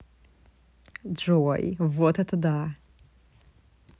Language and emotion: Russian, positive